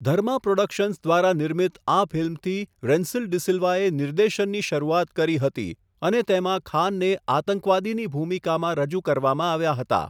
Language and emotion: Gujarati, neutral